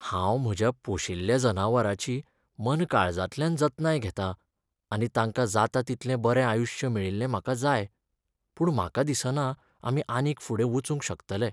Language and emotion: Goan Konkani, sad